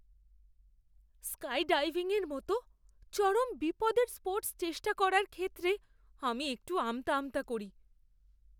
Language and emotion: Bengali, fearful